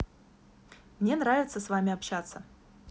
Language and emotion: Russian, positive